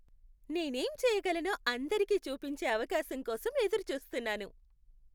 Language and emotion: Telugu, happy